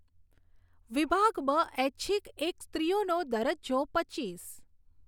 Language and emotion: Gujarati, neutral